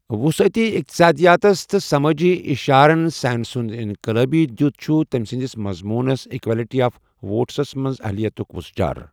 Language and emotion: Kashmiri, neutral